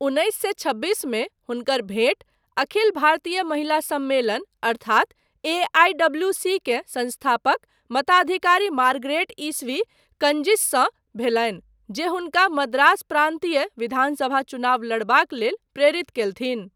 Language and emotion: Maithili, neutral